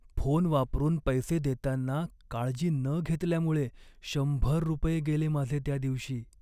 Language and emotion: Marathi, sad